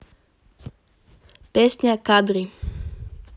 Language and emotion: Russian, neutral